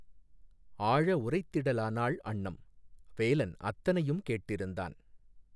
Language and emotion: Tamil, neutral